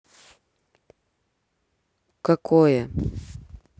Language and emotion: Russian, neutral